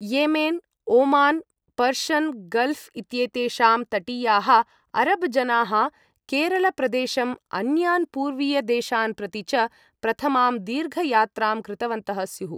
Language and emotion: Sanskrit, neutral